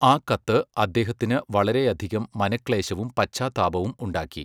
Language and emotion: Malayalam, neutral